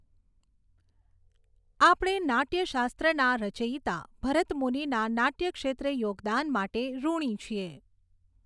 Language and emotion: Gujarati, neutral